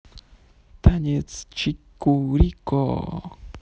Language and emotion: Russian, positive